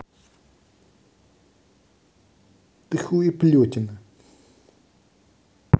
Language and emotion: Russian, angry